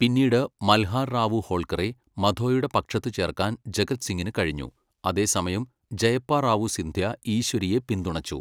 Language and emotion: Malayalam, neutral